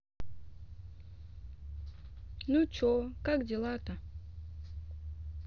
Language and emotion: Russian, neutral